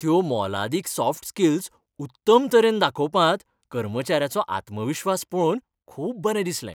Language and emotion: Goan Konkani, happy